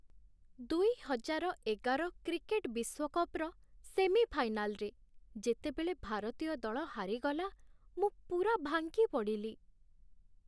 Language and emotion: Odia, sad